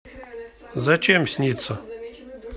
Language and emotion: Russian, neutral